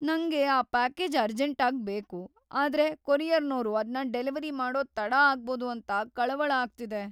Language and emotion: Kannada, fearful